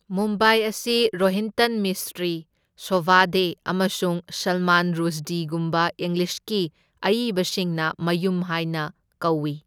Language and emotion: Manipuri, neutral